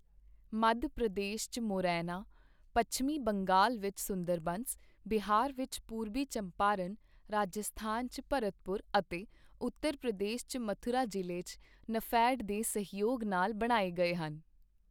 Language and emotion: Punjabi, neutral